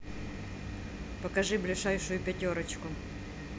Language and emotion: Russian, neutral